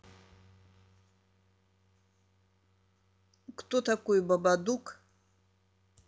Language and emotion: Russian, neutral